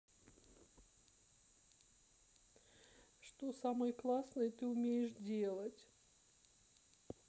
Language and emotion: Russian, sad